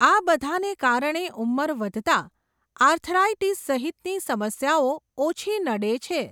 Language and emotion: Gujarati, neutral